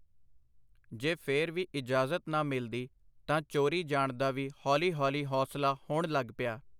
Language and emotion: Punjabi, neutral